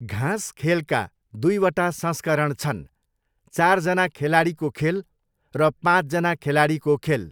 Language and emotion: Nepali, neutral